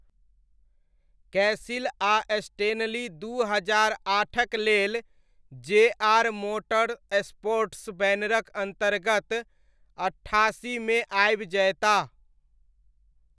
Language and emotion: Maithili, neutral